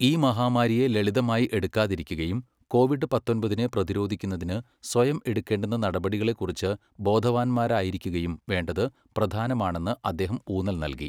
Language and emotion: Malayalam, neutral